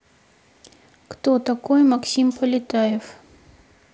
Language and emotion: Russian, neutral